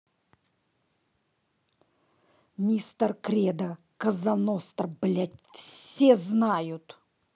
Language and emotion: Russian, angry